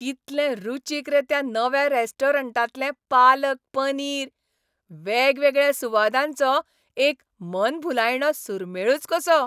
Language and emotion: Goan Konkani, happy